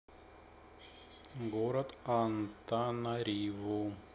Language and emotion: Russian, neutral